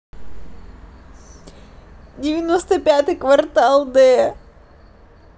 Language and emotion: Russian, positive